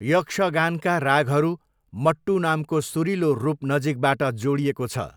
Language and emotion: Nepali, neutral